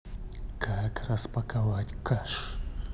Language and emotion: Russian, angry